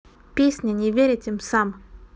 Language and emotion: Russian, neutral